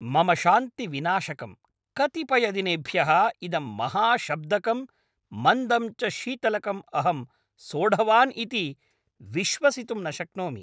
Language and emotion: Sanskrit, angry